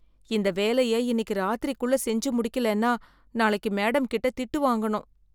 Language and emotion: Tamil, fearful